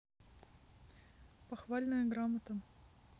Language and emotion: Russian, neutral